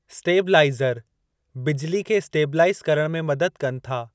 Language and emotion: Sindhi, neutral